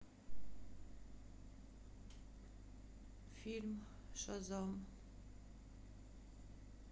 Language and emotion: Russian, sad